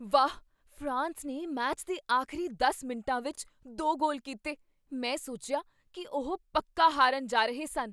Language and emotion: Punjabi, surprised